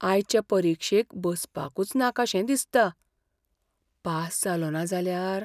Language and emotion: Goan Konkani, fearful